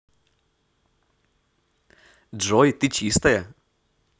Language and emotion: Russian, positive